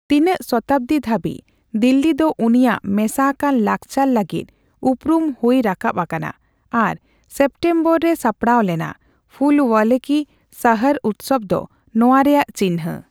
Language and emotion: Santali, neutral